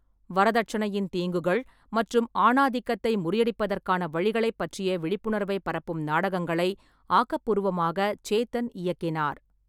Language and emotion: Tamil, neutral